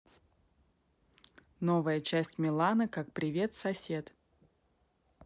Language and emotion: Russian, neutral